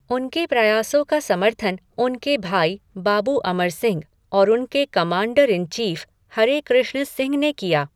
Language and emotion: Hindi, neutral